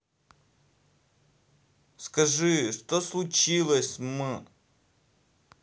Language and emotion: Russian, sad